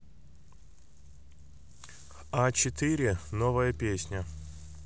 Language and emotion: Russian, neutral